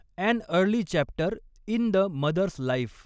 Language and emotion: Marathi, neutral